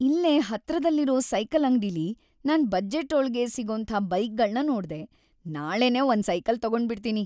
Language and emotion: Kannada, happy